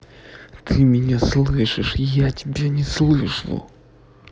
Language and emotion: Russian, angry